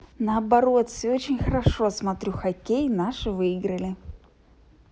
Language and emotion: Russian, positive